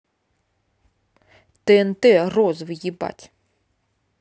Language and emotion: Russian, angry